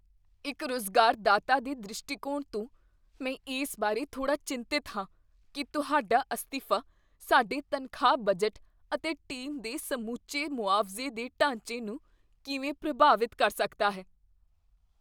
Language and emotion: Punjabi, fearful